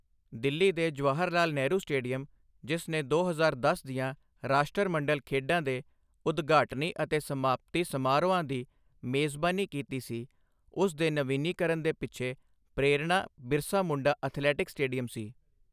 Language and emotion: Punjabi, neutral